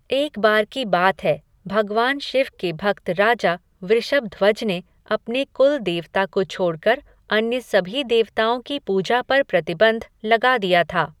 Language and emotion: Hindi, neutral